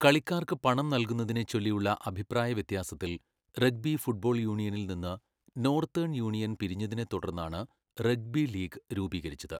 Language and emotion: Malayalam, neutral